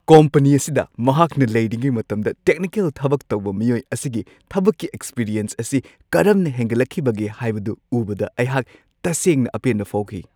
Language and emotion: Manipuri, happy